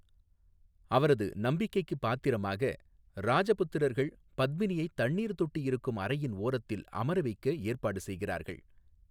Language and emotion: Tamil, neutral